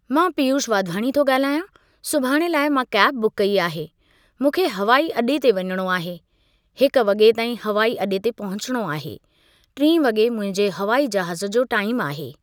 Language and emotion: Sindhi, neutral